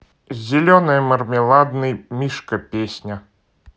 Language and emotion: Russian, neutral